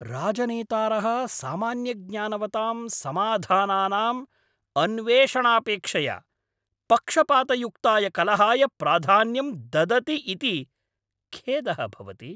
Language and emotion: Sanskrit, angry